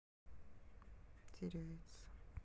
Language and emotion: Russian, sad